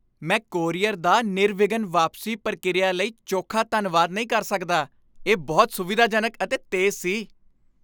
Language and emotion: Punjabi, happy